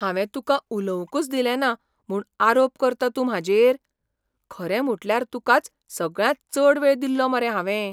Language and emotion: Goan Konkani, surprised